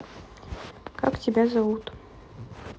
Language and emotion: Russian, neutral